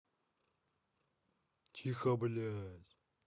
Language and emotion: Russian, angry